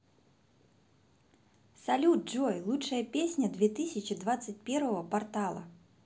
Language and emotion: Russian, positive